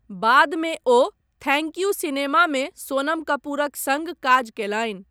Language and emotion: Maithili, neutral